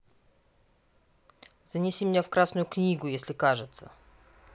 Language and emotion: Russian, neutral